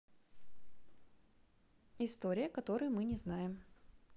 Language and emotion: Russian, positive